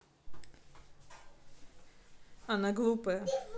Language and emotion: Russian, neutral